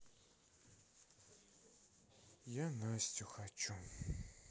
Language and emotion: Russian, sad